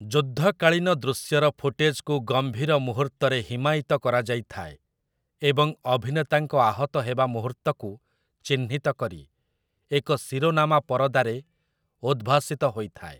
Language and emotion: Odia, neutral